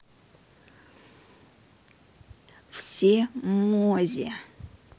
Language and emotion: Russian, neutral